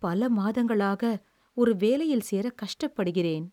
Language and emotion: Tamil, sad